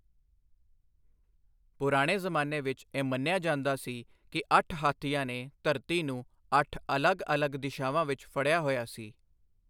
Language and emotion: Punjabi, neutral